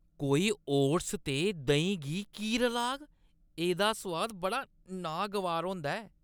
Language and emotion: Dogri, disgusted